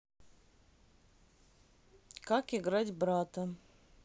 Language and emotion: Russian, neutral